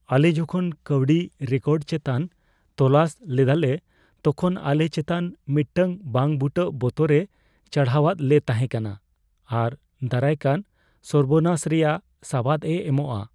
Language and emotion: Santali, fearful